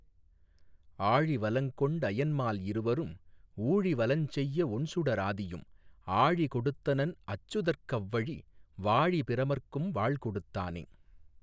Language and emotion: Tamil, neutral